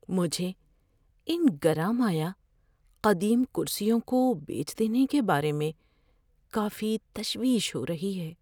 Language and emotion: Urdu, fearful